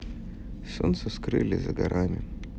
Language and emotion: Russian, sad